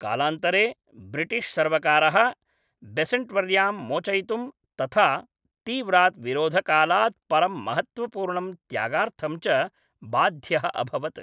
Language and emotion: Sanskrit, neutral